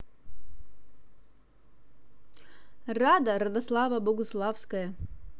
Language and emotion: Russian, positive